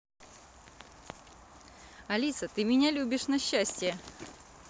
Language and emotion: Russian, positive